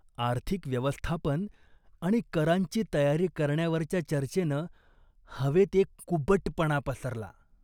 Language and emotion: Marathi, disgusted